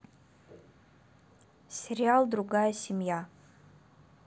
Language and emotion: Russian, neutral